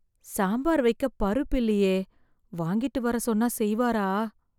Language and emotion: Tamil, fearful